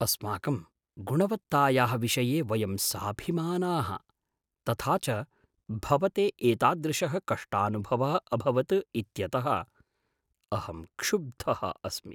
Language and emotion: Sanskrit, surprised